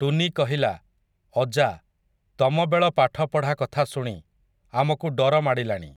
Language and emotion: Odia, neutral